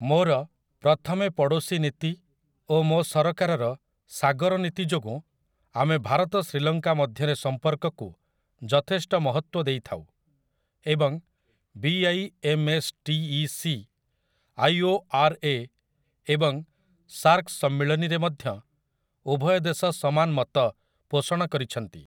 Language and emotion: Odia, neutral